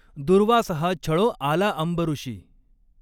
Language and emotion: Marathi, neutral